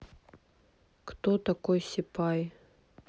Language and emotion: Russian, neutral